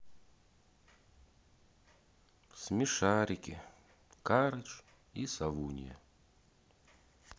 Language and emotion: Russian, sad